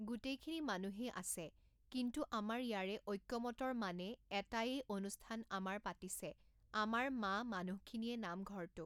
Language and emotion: Assamese, neutral